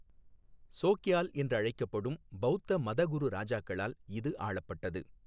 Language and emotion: Tamil, neutral